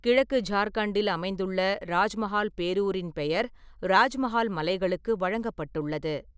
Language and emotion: Tamil, neutral